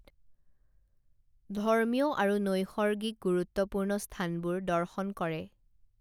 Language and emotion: Assamese, neutral